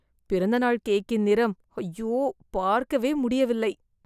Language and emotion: Tamil, disgusted